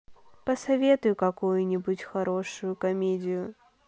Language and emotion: Russian, sad